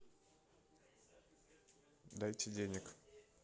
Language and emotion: Russian, neutral